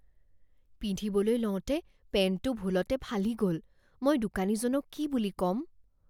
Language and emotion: Assamese, fearful